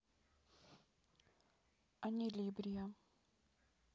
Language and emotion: Russian, neutral